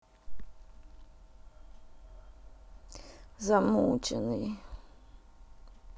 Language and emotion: Russian, sad